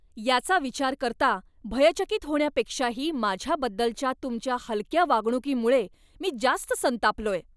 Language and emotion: Marathi, angry